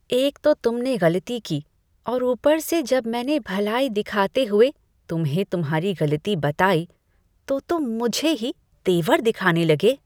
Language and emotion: Hindi, disgusted